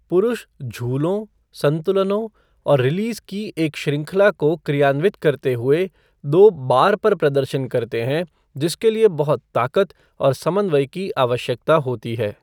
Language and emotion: Hindi, neutral